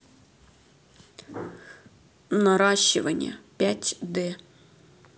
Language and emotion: Russian, sad